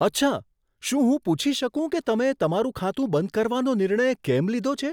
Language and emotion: Gujarati, surprised